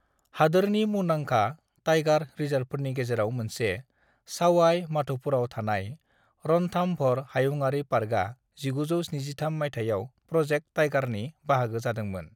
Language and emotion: Bodo, neutral